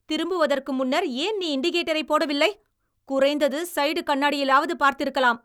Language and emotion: Tamil, angry